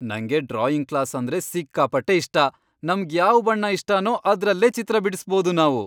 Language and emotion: Kannada, happy